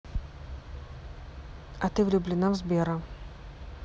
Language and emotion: Russian, neutral